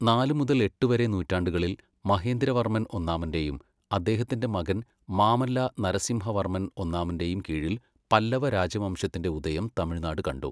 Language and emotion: Malayalam, neutral